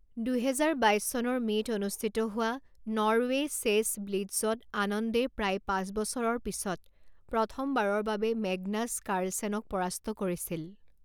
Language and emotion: Assamese, neutral